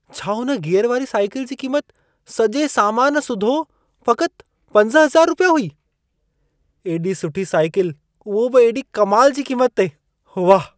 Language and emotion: Sindhi, surprised